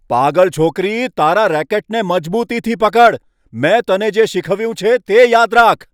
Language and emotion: Gujarati, angry